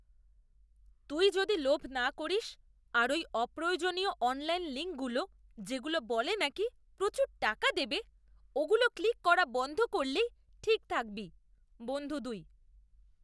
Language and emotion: Bengali, disgusted